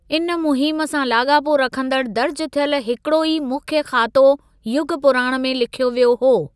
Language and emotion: Sindhi, neutral